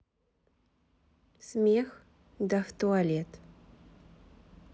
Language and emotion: Russian, neutral